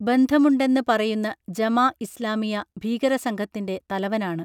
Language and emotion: Malayalam, neutral